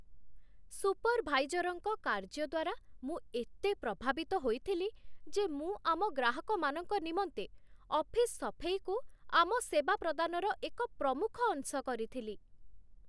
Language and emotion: Odia, surprised